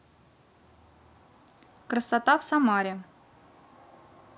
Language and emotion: Russian, neutral